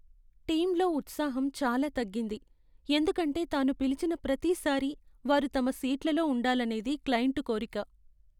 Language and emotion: Telugu, sad